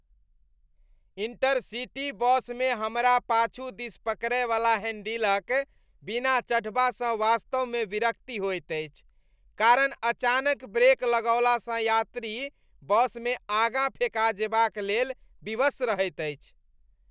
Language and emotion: Maithili, disgusted